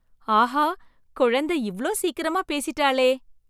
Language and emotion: Tamil, surprised